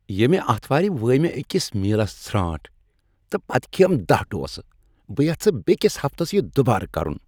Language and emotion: Kashmiri, happy